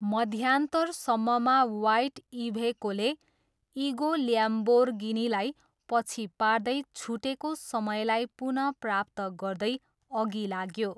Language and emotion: Nepali, neutral